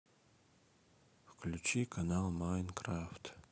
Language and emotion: Russian, sad